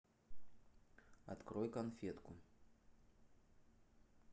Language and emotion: Russian, neutral